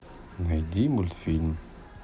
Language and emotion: Russian, sad